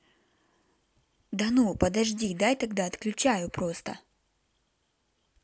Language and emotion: Russian, neutral